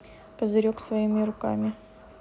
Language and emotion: Russian, neutral